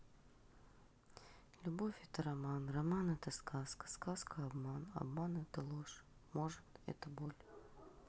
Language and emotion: Russian, neutral